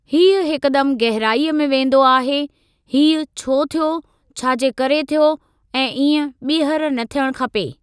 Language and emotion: Sindhi, neutral